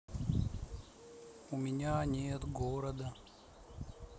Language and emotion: Russian, sad